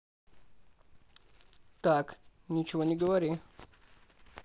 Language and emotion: Russian, neutral